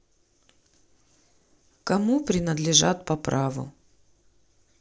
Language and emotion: Russian, neutral